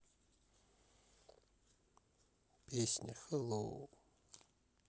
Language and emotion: Russian, sad